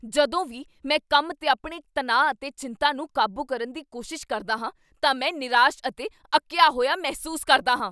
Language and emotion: Punjabi, angry